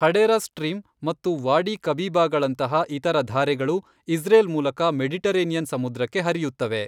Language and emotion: Kannada, neutral